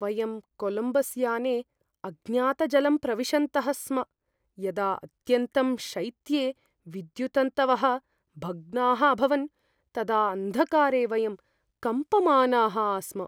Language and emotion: Sanskrit, fearful